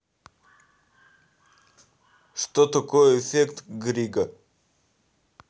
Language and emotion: Russian, neutral